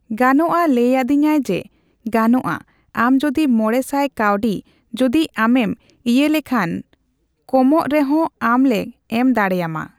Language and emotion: Santali, neutral